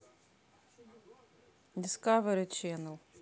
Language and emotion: Russian, neutral